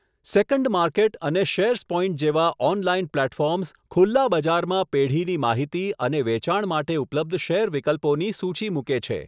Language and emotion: Gujarati, neutral